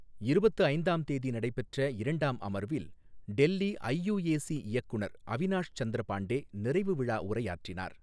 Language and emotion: Tamil, neutral